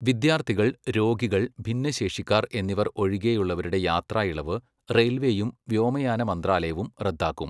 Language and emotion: Malayalam, neutral